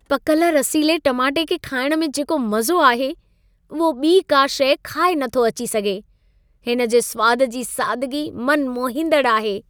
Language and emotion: Sindhi, happy